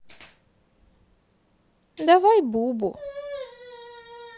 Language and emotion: Russian, sad